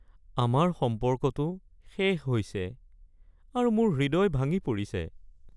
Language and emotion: Assamese, sad